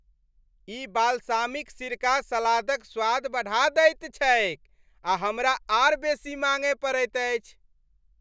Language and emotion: Maithili, happy